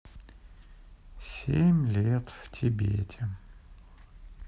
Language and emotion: Russian, sad